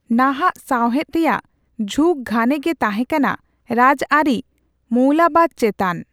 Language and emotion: Santali, neutral